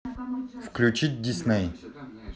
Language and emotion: Russian, neutral